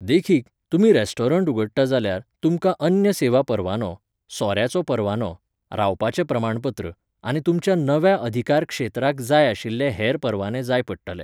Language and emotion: Goan Konkani, neutral